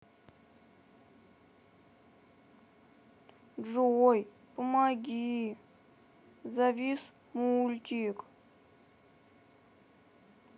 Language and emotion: Russian, sad